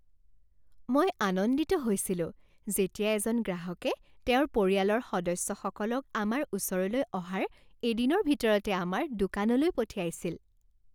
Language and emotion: Assamese, happy